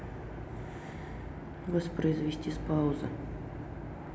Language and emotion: Russian, neutral